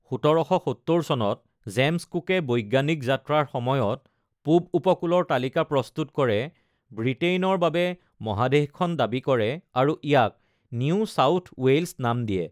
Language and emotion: Assamese, neutral